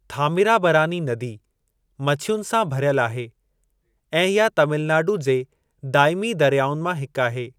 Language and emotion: Sindhi, neutral